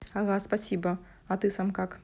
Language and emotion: Russian, positive